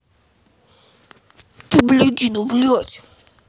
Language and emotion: Russian, angry